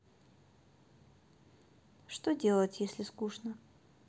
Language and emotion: Russian, sad